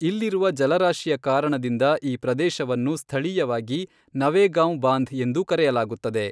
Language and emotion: Kannada, neutral